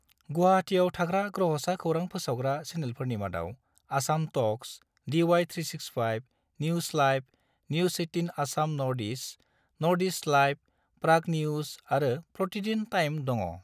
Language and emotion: Bodo, neutral